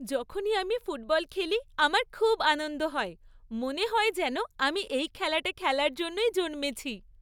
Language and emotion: Bengali, happy